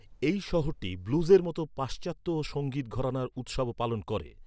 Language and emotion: Bengali, neutral